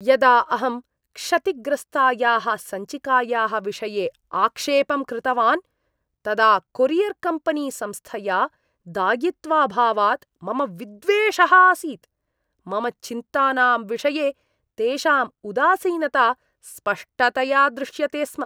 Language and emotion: Sanskrit, disgusted